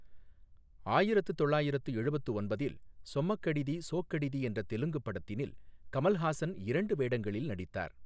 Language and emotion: Tamil, neutral